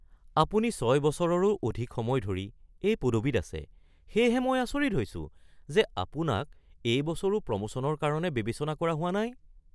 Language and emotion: Assamese, surprised